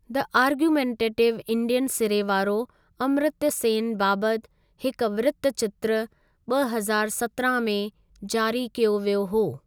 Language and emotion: Sindhi, neutral